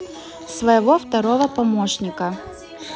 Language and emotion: Russian, neutral